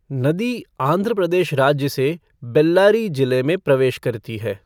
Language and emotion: Hindi, neutral